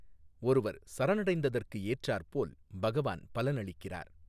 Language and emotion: Tamil, neutral